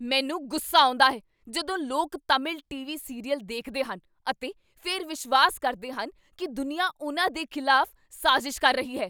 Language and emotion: Punjabi, angry